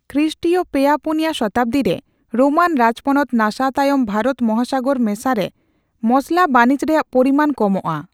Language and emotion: Santali, neutral